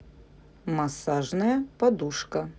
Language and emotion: Russian, neutral